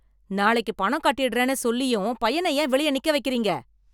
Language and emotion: Tamil, angry